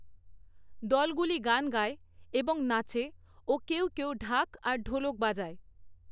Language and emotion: Bengali, neutral